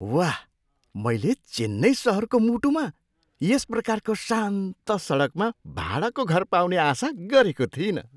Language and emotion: Nepali, surprised